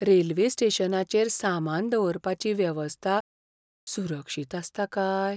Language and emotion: Goan Konkani, fearful